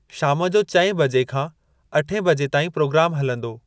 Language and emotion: Sindhi, neutral